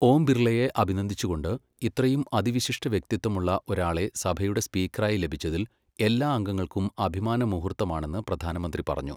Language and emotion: Malayalam, neutral